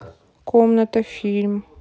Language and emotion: Russian, neutral